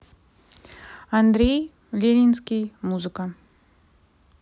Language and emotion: Russian, neutral